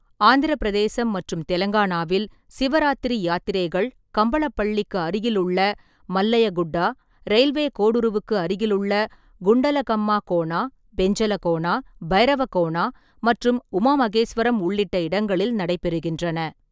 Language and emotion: Tamil, neutral